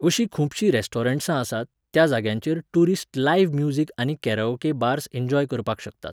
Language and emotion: Goan Konkani, neutral